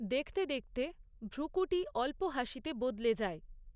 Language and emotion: Bengali, neutral